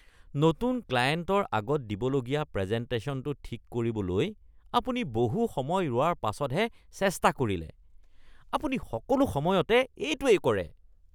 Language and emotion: Assamese, disgusted